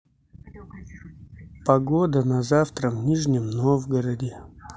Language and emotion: Russian, neutral